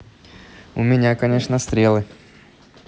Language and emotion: Russian, neutral